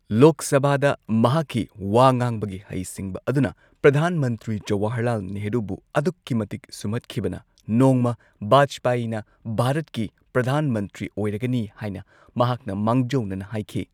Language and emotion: Manipuri, neutral